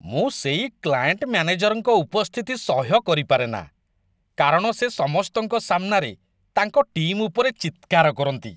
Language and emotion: Odia, disgusted